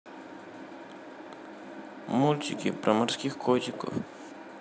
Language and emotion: Russian, sad